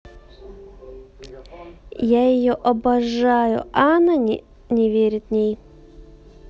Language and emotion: Russian, sad